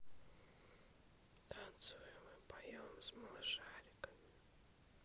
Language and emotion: Russian, neutral